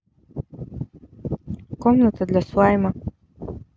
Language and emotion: Russian, neutral